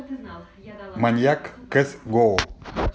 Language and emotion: Russian, neutral